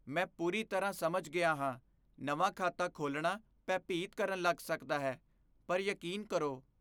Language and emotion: Punjabi, fearful